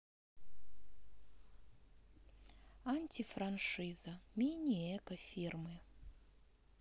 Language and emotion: Russian, sad